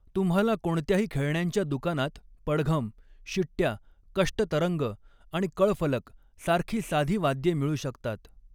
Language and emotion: Marathi, neutral